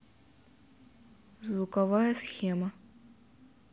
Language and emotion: Russian, neutral